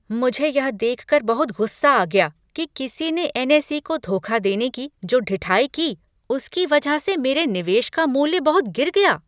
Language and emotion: Hindi, angry